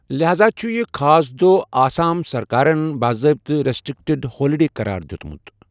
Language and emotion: Kashmiri, neutral